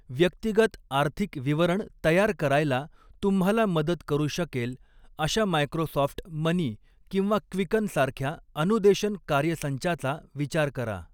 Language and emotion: Marathi, neutral